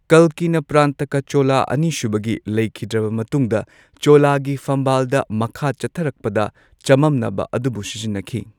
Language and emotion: Manipuri, neutral